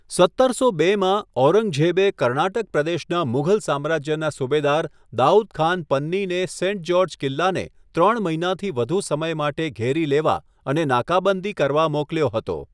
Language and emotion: Gujarati, neutral